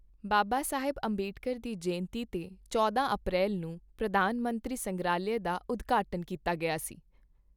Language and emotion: Punjabi, neutral